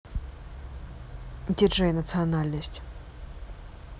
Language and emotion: Russian, neutral